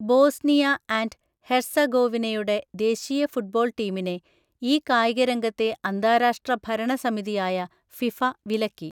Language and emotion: Malayalam, neutral